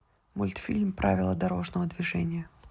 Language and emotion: Russian, neutral